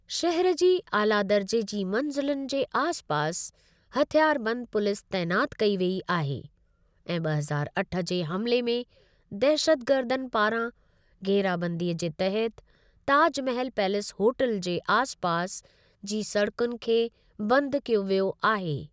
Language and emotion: Sindhi, neutral